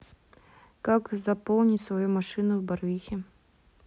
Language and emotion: Russian, neutral